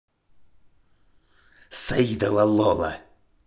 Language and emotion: Russian, angry